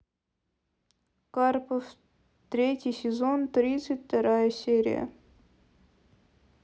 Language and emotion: Russian, sad